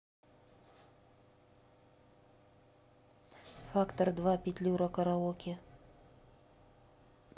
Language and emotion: Russian, neutral